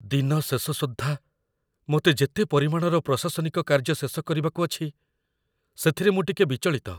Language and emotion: Odia, fearful